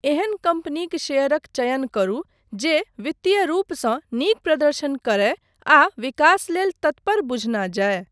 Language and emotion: Maithili, neutral